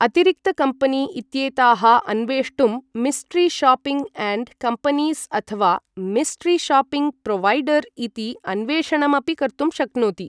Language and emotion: Sanskrit, neutral